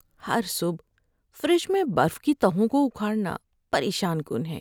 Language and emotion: Urdu, sad